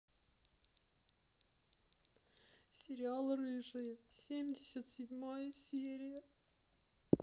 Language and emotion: Russian, sad